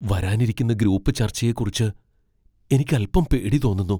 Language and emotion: Malayalam, fearful